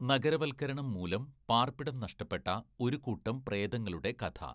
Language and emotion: Malayalam, neutral